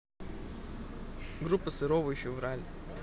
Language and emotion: Russian, neutral